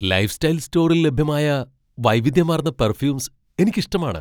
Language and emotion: Malayalam, surprised